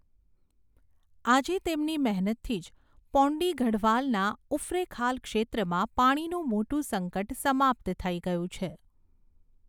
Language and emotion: Gujarati, neutral